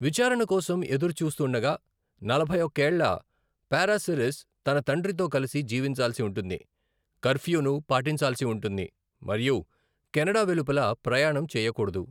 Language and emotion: Telugu, neutral